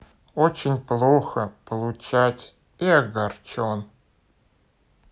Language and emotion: Russian, neutral